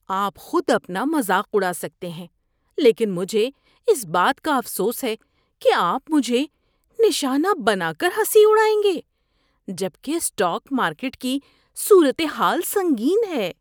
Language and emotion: Urdu, disgusted